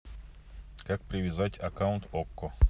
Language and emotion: Russian, neutral